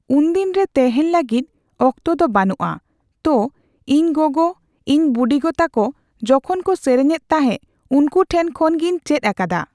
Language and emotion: Santali, neutral